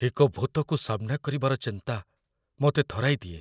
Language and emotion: Odia, fearful